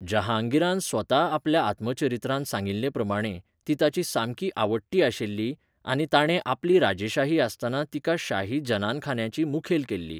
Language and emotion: Goan Konkani, neutral